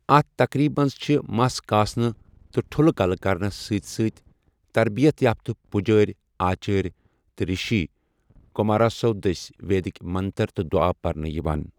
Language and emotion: Kashmiri, neutral